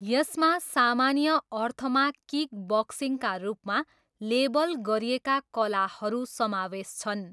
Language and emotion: Nepali, neutral